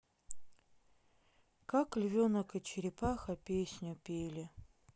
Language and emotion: Russian, sad